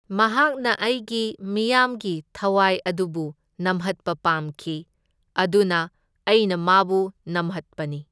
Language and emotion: Manipuri, neutral